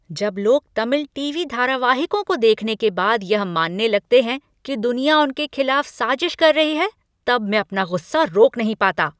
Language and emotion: Hindi, angry